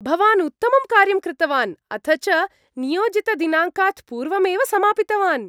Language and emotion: Sanskrit, happy